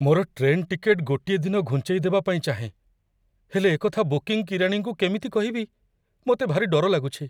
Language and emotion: Odia, fearful